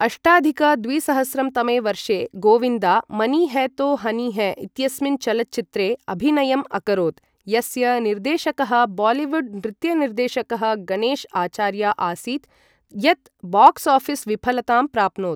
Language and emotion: Sanskrit, neutral